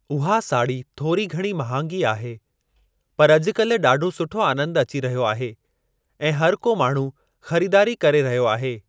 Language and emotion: Sindhi, neutral